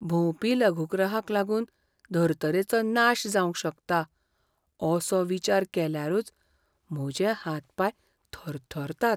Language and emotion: Goan Konkani, fearful